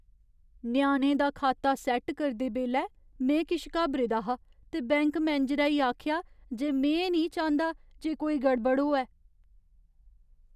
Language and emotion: Dogri, fearful